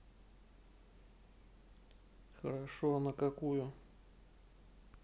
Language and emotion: Russian, neutral